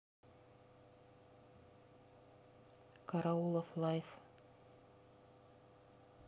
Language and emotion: Russian, neutral